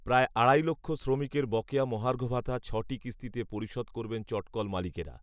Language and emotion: Bengali, neutral